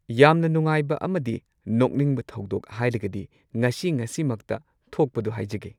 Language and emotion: Manipuri, neutral